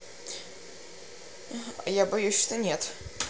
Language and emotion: Russian, neutral